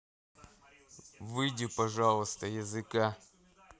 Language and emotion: Russian, neutral